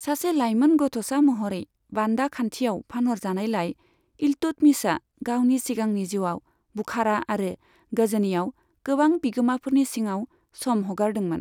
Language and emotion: Bodo, neutral